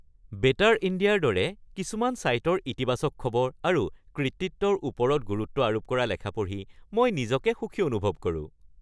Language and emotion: Assamese, happy